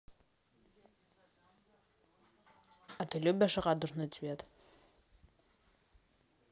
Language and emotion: Russian, neutral